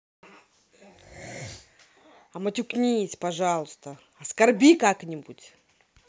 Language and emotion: Russian, angry